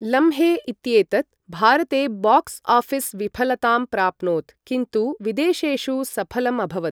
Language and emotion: Sanskrit, neutral